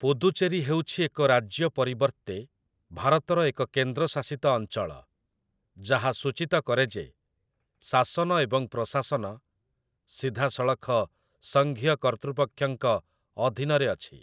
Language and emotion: Odia, neutral